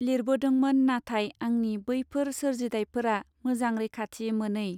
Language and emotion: Bodo, neutral